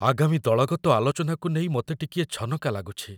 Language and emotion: Odia, fearful